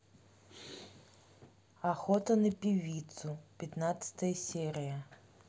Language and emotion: Russian, neutral